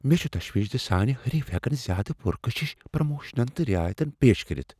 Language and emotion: Kashmiri, fearful